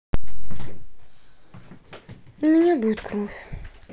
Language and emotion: Russian, sad